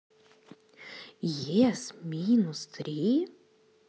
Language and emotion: Russian, positive